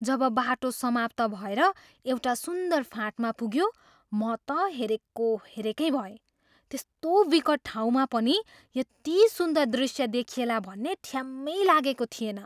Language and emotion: Nepali, surprised